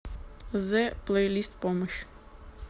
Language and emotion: Russian, neutral